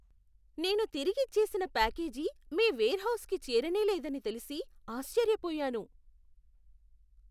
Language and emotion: Telugu, surprised